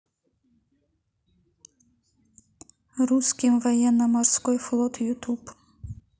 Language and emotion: Russian, neutral